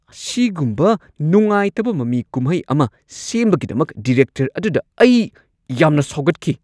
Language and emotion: Manipuri, angry